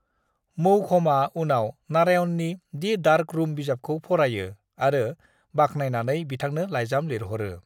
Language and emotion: Bodo, neutral